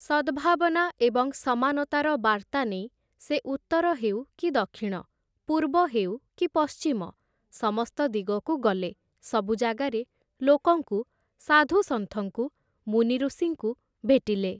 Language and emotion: Odia, neutral